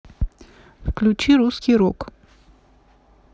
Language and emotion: Russian, neutral